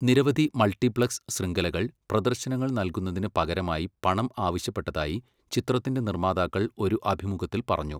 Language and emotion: Malayalam, neutral